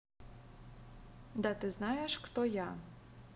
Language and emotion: Russian, neutral